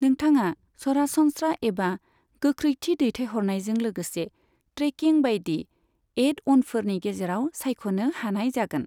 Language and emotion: Bodo, neutral